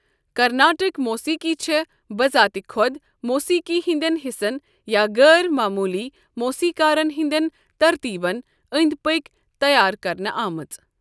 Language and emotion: Kashmiri, neutral